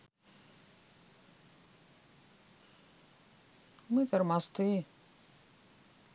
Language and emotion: Russian, sad